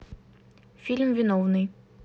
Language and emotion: Russian, neutral